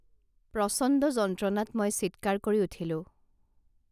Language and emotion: Assamese, neutral